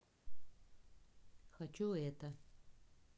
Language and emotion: Russian, neutral